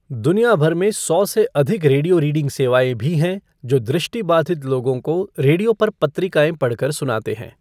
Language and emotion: Hindi, neutral